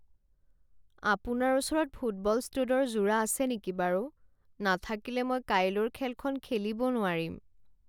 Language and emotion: Assamese, sad